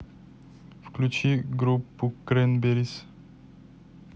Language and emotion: Russian, neutral